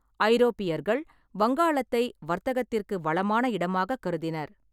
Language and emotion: Tamil, neutral